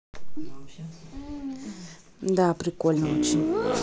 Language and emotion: Russian, neutral